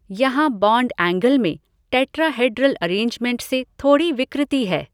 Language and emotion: Hindi, neutral